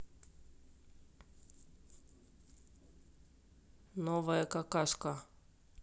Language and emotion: Russian, neutral